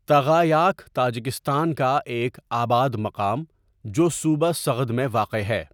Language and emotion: Urdu, neutral